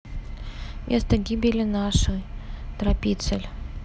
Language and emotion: Russian, neutral